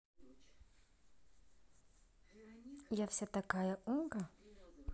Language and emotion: Russian, neutral